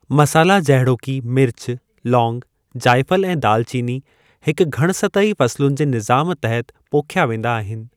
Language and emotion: Sindhi, neutral